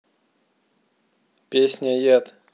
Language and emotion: Russian, neutral